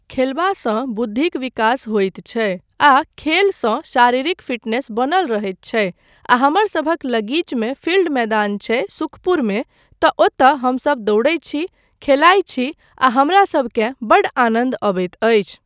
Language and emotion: Maithili, neutral